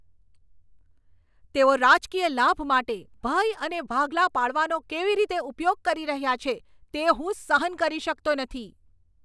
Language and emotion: Gujarati, angry